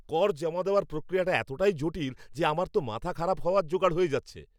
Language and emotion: Bengali, angry